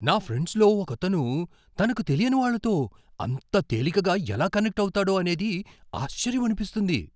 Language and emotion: Telugu, surprised